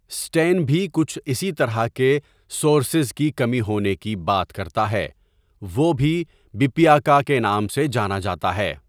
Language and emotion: Urdu, neutral